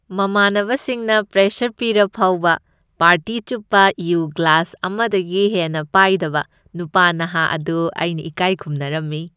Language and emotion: Manipuri, happy